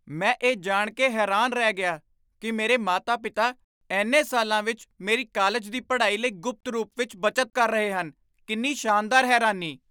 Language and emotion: Punjabi, surprised